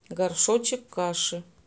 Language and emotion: Russian, neutral